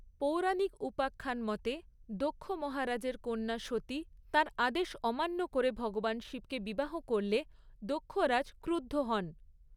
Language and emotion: Bengali, neutral